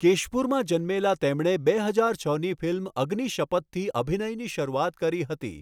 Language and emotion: Gujarati, neutral